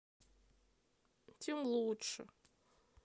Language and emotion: Russian, sad